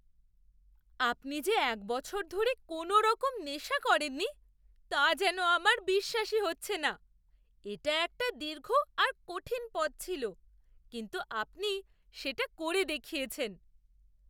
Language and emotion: Bengali, surprised